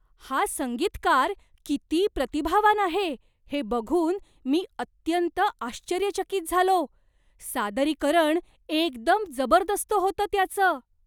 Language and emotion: Marathi, surprised